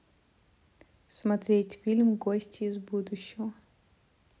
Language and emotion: Russian, neutral